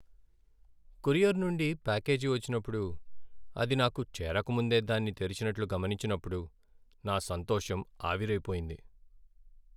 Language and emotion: Telugu, sad